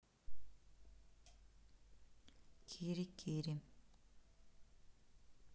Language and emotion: Russian, neutral